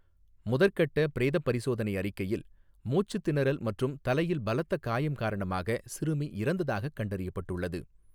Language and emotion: Tamil, neutral